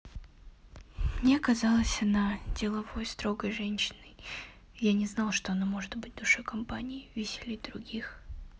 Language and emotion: Russian, neutral